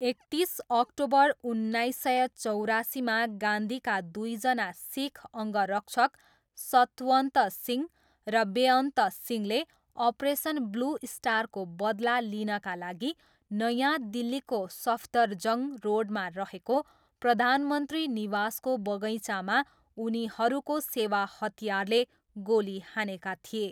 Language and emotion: Nepali, neutral